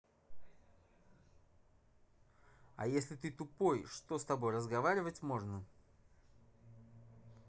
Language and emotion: Russian, angry